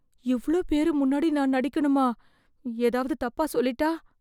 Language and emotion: Tamil, fearful